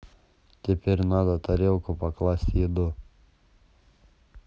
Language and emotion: Russian, neutral